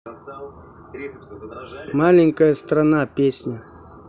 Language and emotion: Russian, neutral